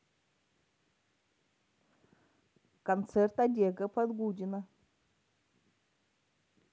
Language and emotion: Russian, neutral